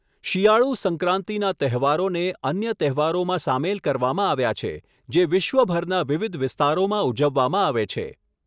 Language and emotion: Gujarati, neutral